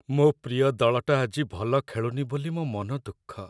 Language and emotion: Odia, sad